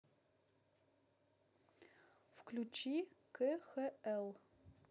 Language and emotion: Russian, neutral